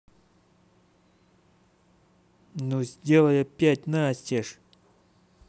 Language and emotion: Russian, angry